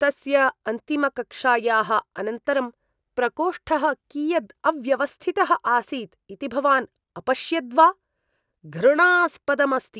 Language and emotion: Sanskrit, disgusted